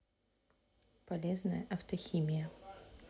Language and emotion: Russian, neutral